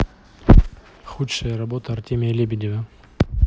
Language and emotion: Russian, neutral